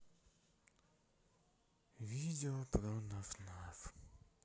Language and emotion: Russian, sad